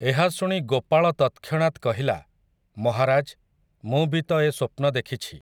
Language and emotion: Odia, neutral